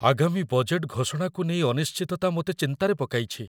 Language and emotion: Odia, fearful